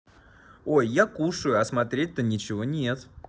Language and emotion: Russian, positive